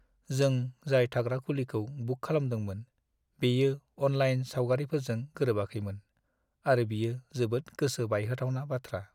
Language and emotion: Bodo, sad